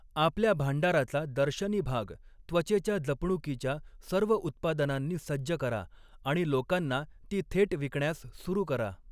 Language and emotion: Marathi, neutral